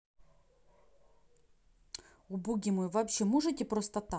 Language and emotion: Russian, angry